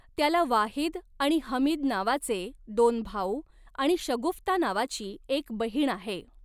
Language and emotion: Marathi, neutral